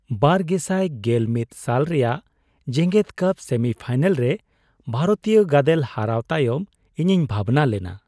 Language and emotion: Santali, sad